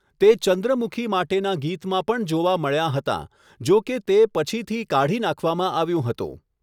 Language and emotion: Gujarati, neutral